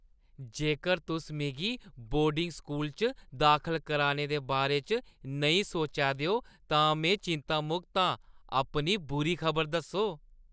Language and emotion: Dogri, happy